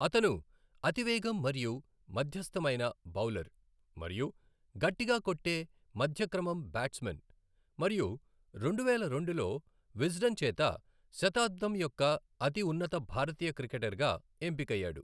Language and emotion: Telugu, neutral